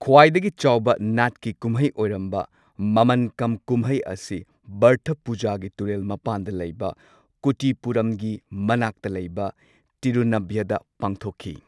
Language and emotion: Manipuri, neutral